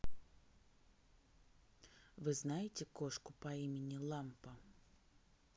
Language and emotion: Russian, neutral